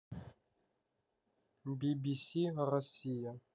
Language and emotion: Russian, neutral